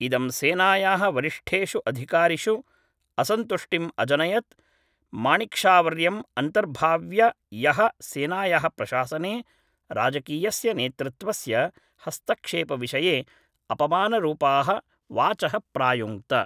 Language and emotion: Sanskrit, neutral